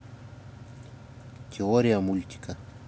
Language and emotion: Russian, neutral